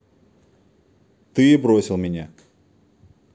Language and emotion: Russian, neutral